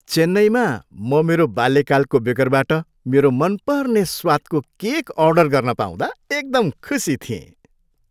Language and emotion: Nepali, happy